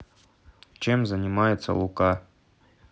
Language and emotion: Russian, neutral